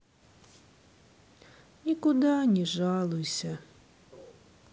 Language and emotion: Russian, sad